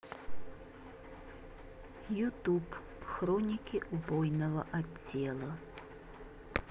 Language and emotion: Russian, neutral